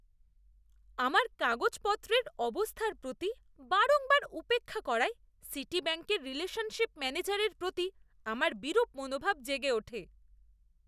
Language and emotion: Bengali, disgusted